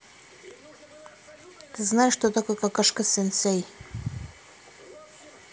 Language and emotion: Russian, neutral